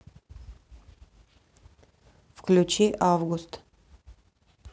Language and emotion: Russian, neutral